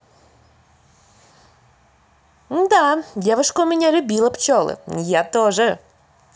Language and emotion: Russian, positive